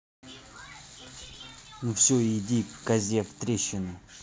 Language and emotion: Russian, angry